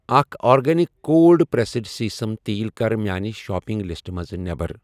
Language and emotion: Kashmiri, neutral